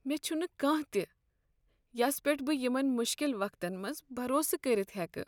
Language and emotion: Kashmiri, sad